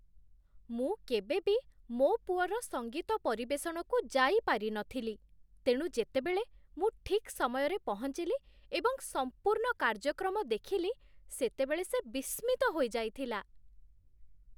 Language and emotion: Odia, surprised